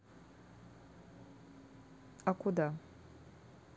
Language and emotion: Russian, neutral